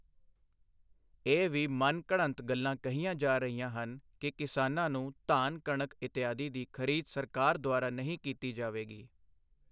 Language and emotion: Punjabi, neutral